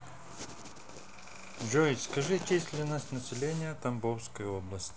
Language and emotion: Russian, neutral